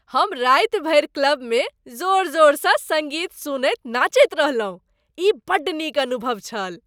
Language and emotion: Maithili, happy